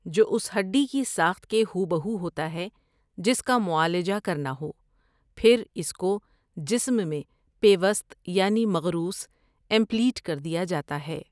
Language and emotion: Urdu, neutral